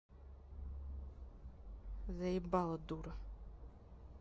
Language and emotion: Russian, angry